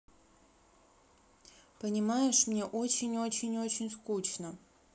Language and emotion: Russian, sad